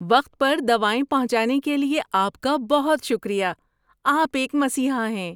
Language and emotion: Urdu, happy